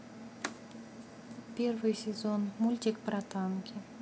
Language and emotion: Russian, neutral